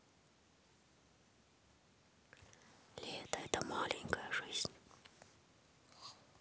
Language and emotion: Russian, neutral